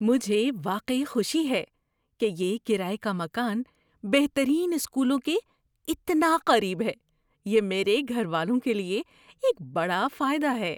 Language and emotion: Urdu, surprised